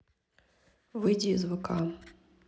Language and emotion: Russian, neutral